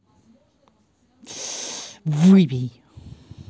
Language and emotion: Russian, angry